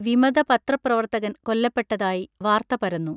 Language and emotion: Malayalam, neutral